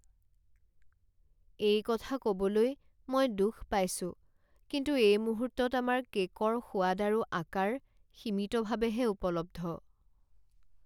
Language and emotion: Assamese, sad